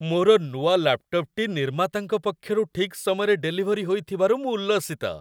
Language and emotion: Odia, happy